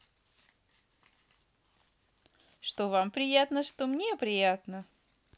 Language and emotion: Russian, positive